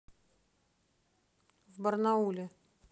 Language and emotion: Russian, neutral